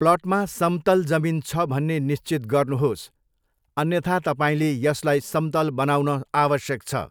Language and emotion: Nepali, neutral